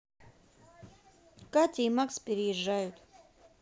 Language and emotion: Russian, neutral